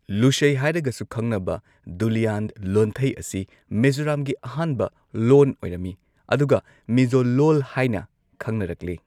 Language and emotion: Manipuri, neutral